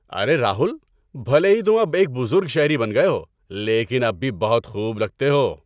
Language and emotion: Urdu, happy